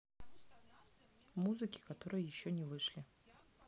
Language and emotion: Russian, neutral